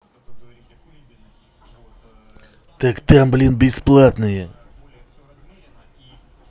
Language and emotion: Russian, angry